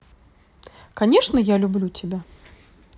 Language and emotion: Russian, positive